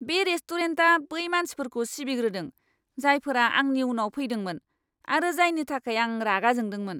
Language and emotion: Bodo, angry